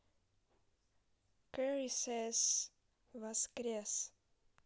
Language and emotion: Russian, neutral